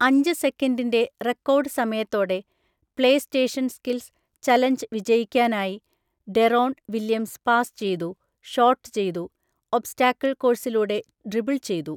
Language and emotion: Malayalam, neutral